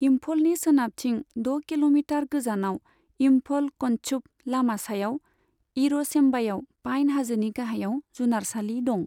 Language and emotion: Bodo, neutral